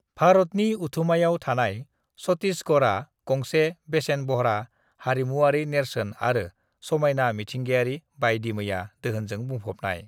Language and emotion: Bodo, neutral